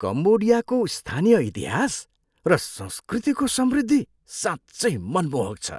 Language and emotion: Nepali, surprised